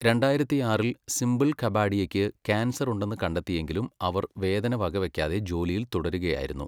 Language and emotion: Malayalam, neutral